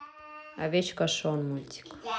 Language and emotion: Russian, neutral